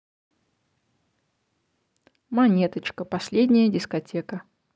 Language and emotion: Russian, neutral